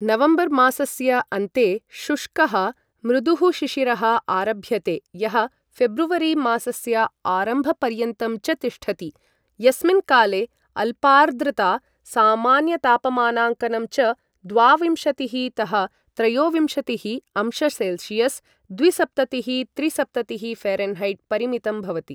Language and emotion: Sanskrit, neutral